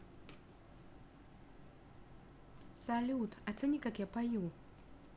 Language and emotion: Russian, neutral